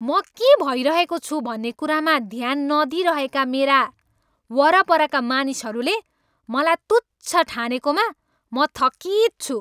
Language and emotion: Nepali, angry